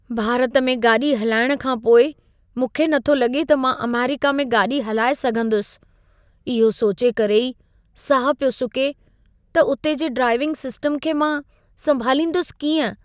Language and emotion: Sindhi, fearful